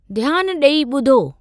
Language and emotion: Sindhi, neutral